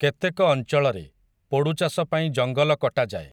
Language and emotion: Odia, neutral